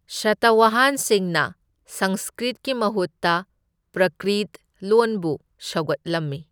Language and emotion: Manipuri, neutral